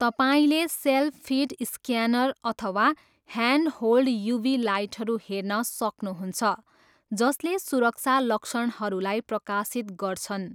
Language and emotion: Nepali, neutral